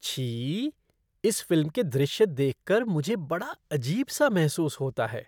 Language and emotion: Hindi, disgusted